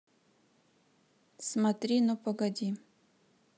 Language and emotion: Russian, neutral